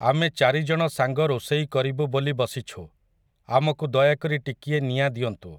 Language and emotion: Odia, neutral